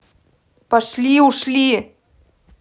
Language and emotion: Russian, angry